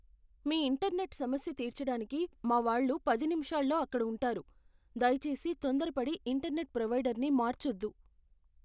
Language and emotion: Telugu, fearful